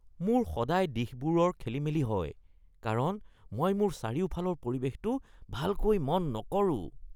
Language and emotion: Assamese, disgusted